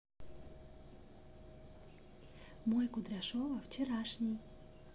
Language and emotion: Russian, neutral